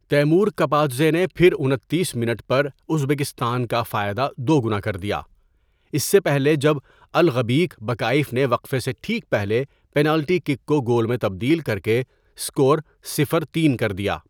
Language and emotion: Urdu, neutral